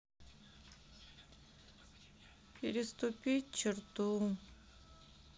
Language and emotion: Russian, sad